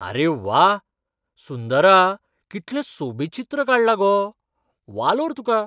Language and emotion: Goan Konkani, surprised